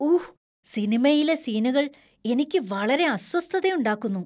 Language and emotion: Malayalam, disgusted